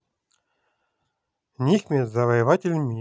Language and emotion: Russian, positive